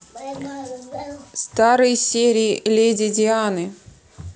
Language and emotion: Russian, neutral